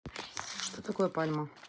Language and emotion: Russian, neutral